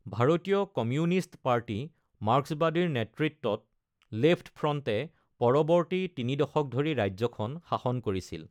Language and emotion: Assamese, neutral